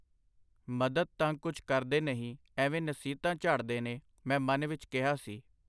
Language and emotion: Punjabi, neutral